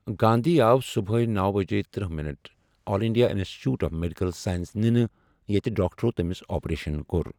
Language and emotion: Kashmiri, neutral